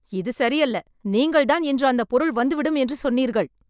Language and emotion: Tamil, angry